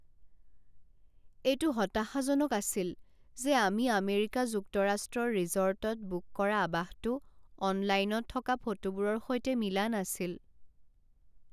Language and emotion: Assamese, sad